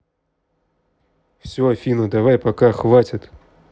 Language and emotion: Russian, angry